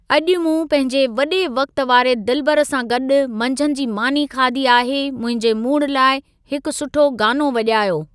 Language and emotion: Sindhi, neutral